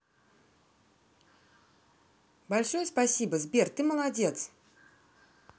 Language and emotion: Russian, positive